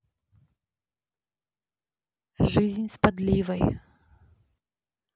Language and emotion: Russian, neutral